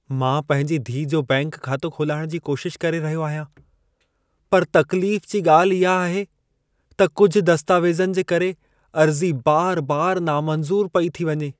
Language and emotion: Sindhi, sad